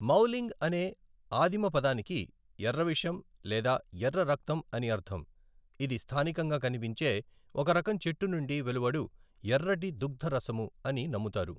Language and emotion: Telugu, neutral